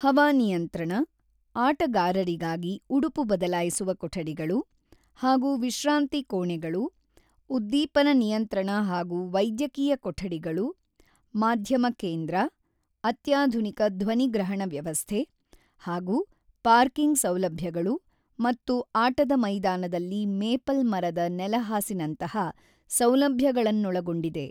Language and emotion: Kannada, neutral